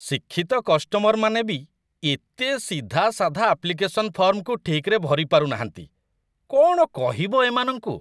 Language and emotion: Odia, disgusted